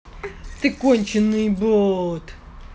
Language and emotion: Russian, angry